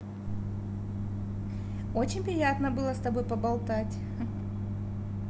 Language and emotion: Russian, positive